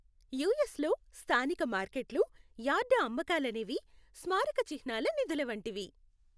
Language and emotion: Telugu, happy